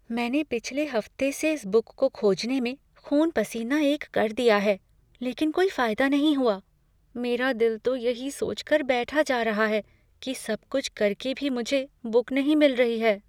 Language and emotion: Hindi, fearful